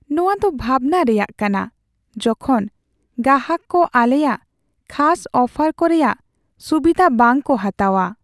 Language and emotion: Santali, sad